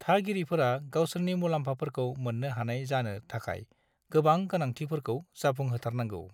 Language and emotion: Bodo, neutral